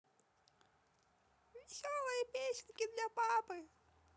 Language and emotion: Russian, positive